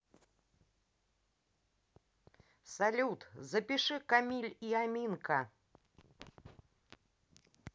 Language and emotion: Russian, neutral